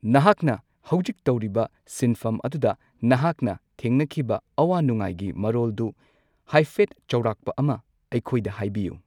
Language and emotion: Manipuri, neutral